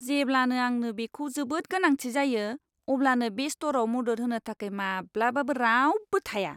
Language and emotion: Bodo, disgusted